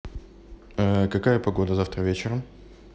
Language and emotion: Russian, neutral